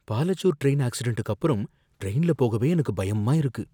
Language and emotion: Tamil, fearful